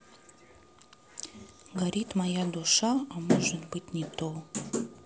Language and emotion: Russian, sad